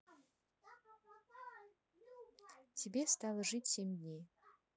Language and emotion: Russian, neutral